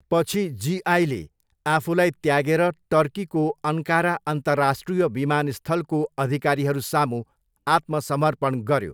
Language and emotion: Nepali, neutral